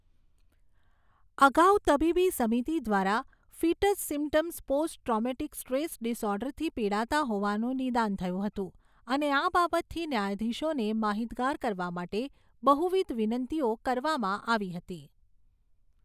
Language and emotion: Gujarati, neutral